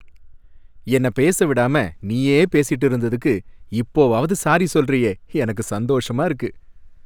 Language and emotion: Tamil, happy